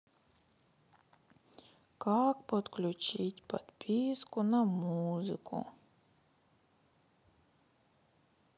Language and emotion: Russian, sad